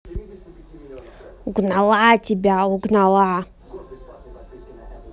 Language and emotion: Russian, angry